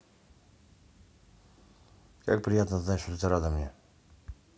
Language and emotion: Russian, neutral